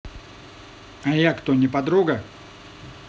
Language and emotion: Russian, angry